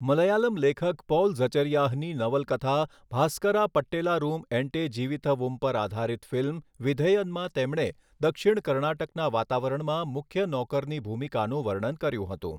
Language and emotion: Gujarati, neutral